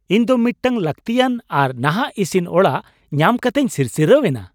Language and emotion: Santali, happy